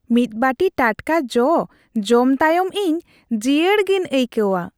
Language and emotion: Santali, happy